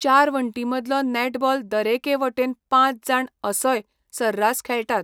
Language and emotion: Goan Konkani, neutral